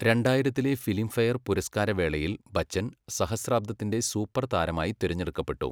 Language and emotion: Malayalam, neutral